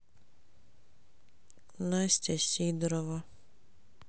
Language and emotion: Russian, sad